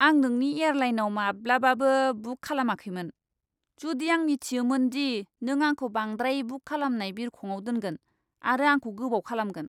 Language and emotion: Bodo, disgusted